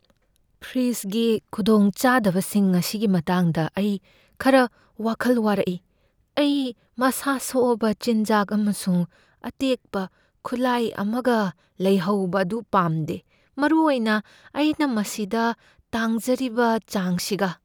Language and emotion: Manipuri, fearful